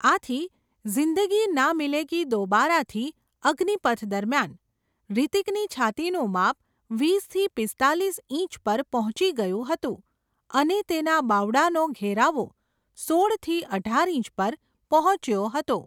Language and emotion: Gujarati, neutral